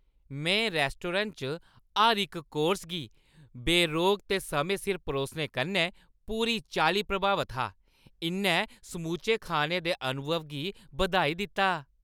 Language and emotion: Dogri, happy